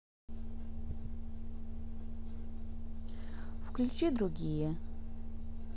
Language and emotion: Russian, neutral